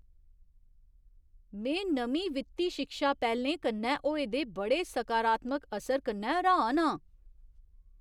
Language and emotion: Dogri, surprised